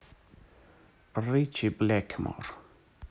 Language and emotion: Russian, neutral